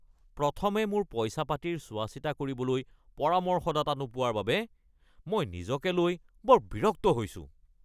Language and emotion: Assamese, angry